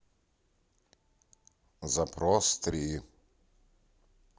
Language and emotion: Russian, neutral